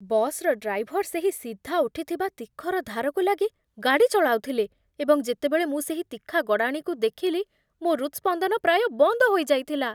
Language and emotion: Odia, fearful